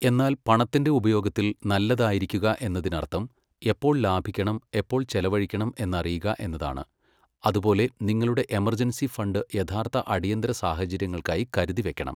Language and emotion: Malayalam, neutral